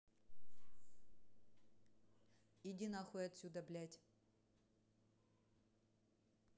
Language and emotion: Russian, angry